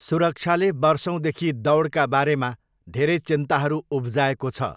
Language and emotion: Nepali, neutral